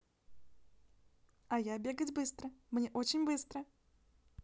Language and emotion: Russian, positive